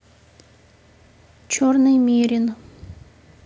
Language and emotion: Russian, neutral